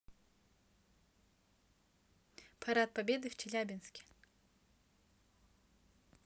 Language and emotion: Russian, neutral